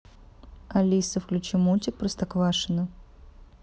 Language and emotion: Russian, neutral